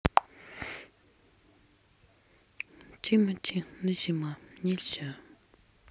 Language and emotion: Russian, sad